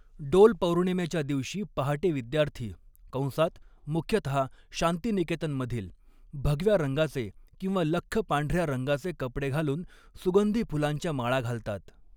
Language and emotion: Marathi, neutral